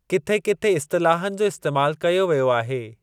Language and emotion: Sindhi, neutral